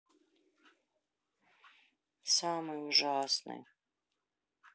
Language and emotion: Russian, sad